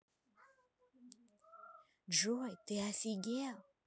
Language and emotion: Russian, neutral